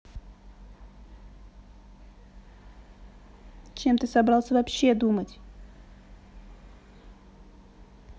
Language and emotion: Russian, angry